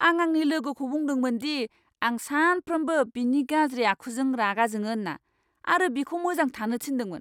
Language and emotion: Bodo, angry